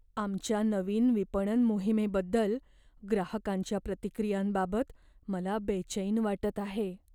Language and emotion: Marathi, fearful